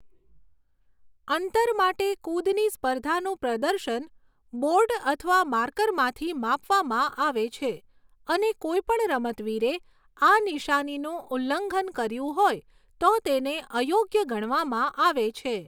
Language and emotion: Gujarati, neutral